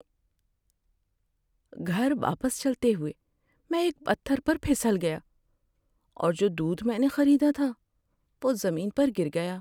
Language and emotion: Urdu, sad